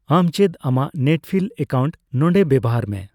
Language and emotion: Santali, neutral